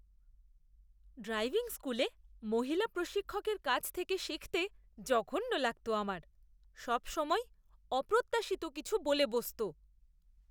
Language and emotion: Bengali, disgusted